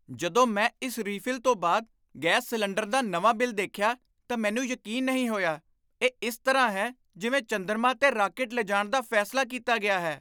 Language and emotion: Punjabi, surprised